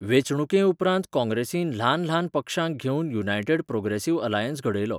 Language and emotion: Goan Konkani, neutral